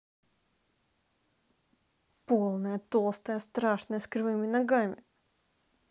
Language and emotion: Russian, angry